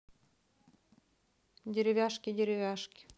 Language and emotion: Russian, neutral